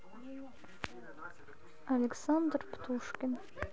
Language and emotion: Russian, sad